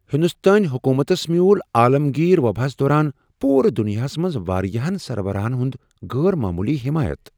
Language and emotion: Kashmiri, surprised